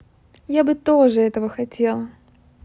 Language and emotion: Russian, positive